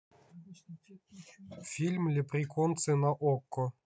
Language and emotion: Russian, neutral